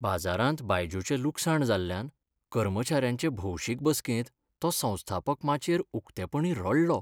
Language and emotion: Goan Konkani, sad